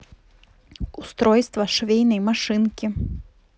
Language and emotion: Russian, neutral